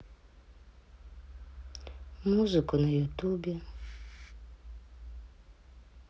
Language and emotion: Russian, sad